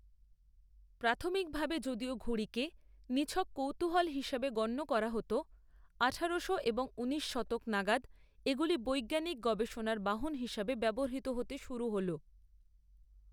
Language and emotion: Bengali, neutral